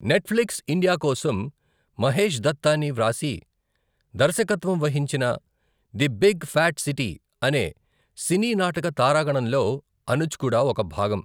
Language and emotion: Telugu, neutral